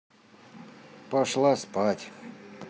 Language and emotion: Russian, neutral